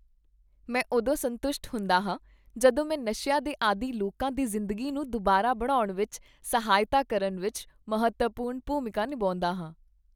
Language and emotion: Punjabi, happy